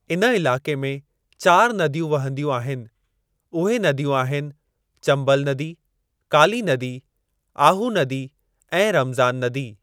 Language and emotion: Sindhi, neutral